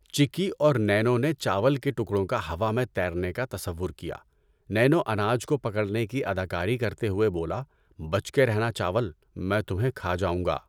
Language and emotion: Urdu, neutral